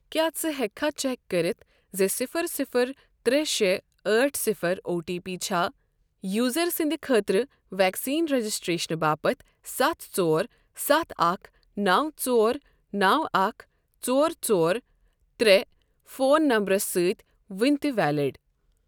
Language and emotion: Kashmiri, neutral